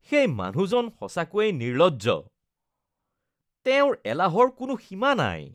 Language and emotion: Assamese, disgusted